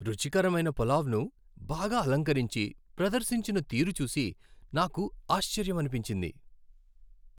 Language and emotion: Telugu, happy